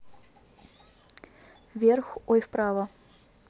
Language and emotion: Russian, neutral